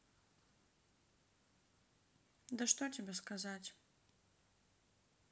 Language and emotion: Russian, sad